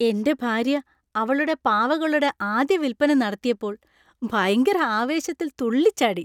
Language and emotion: Malayalam, happy